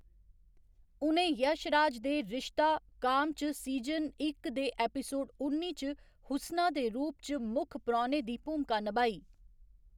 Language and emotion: Dogri, neutral